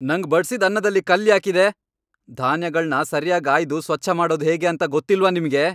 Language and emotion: Kannada, angry